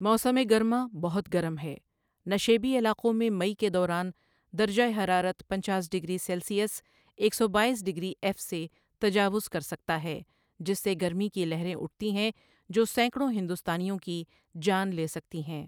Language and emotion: Urdu, neutral